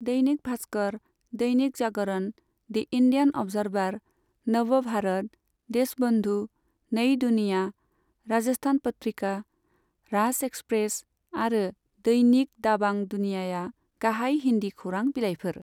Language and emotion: Bodo, neutral